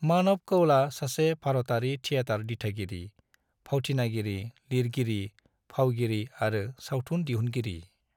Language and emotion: Bodo, neutral